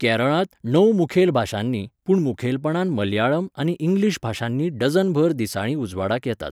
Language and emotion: Goan Konkani, neutral